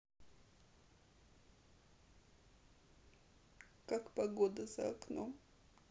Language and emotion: Russian, sad